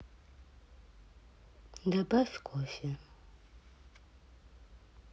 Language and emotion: Russian, neutral